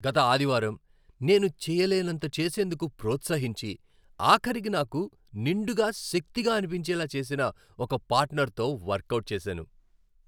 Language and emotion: Telugu, happy